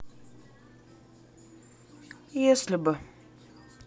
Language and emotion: Russian, sad